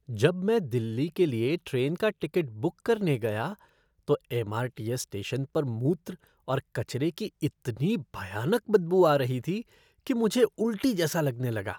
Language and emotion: Hindi, disgusted